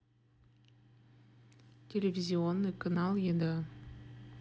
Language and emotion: Russian, neutral